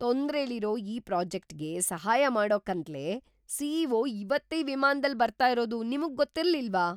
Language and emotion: Kannada, surprised